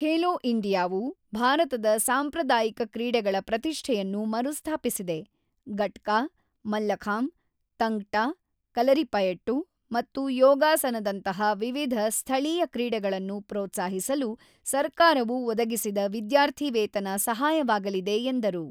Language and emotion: Kannada, neutral